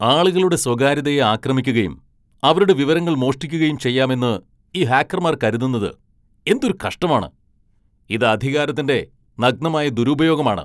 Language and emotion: Malayalam, angry